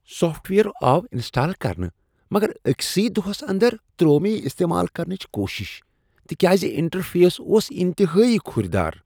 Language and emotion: Kashmiri, disgusted